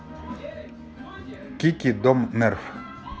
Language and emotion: Russian, neutral